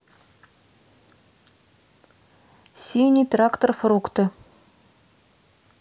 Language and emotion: Russian, neutral